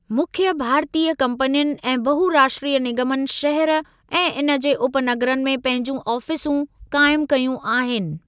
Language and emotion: Sindhi, neutral